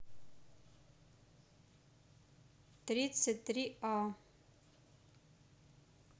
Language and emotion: Russian, neutral